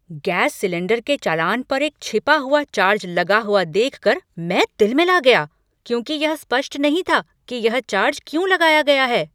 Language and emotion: Hindi, angry